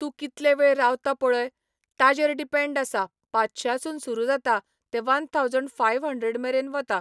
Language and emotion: Goan Konkani, neutral